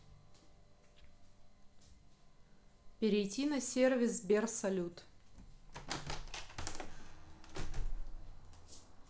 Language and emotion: Russian, neutral